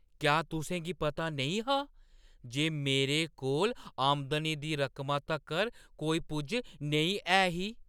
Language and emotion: Dogri, surprised